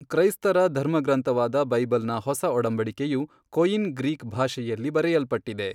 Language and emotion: Kannada, neutral